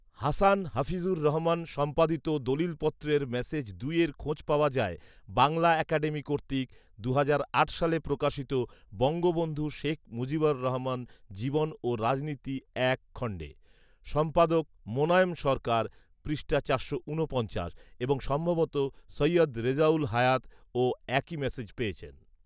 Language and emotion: Bengali, neutral